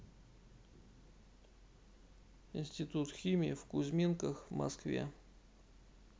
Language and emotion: Russian, neutral